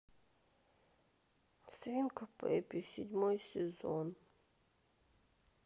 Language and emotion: Russian, sad